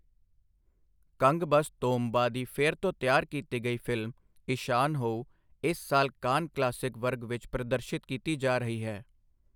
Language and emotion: Punjabi, neutral